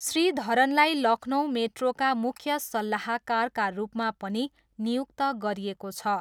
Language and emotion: Nepali, neutral